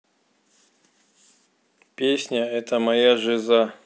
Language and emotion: Russian, neutral